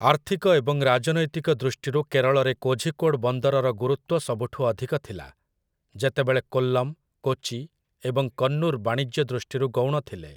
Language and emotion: Odia, neutral